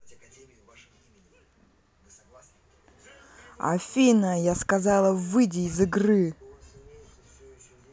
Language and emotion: Russian, angry